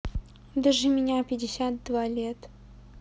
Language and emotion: Russian, neutral